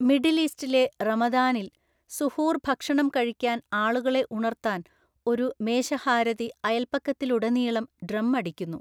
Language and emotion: Malayalam, neutral